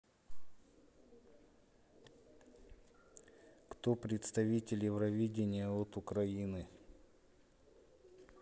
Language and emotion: Russian, neutral